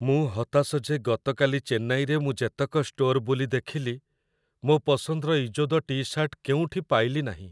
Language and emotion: Odia, sad